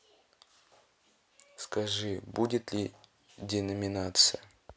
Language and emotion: Russian, neutral